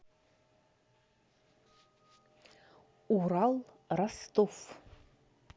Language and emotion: Russian, neutral